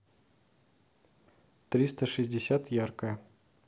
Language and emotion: Russian, neutral